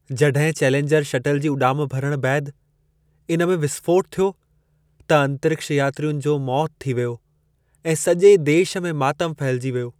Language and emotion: Sindhi, sad